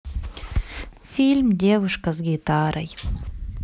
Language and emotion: Russian, sad